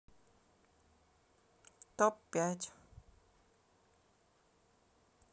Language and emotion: Russian, sad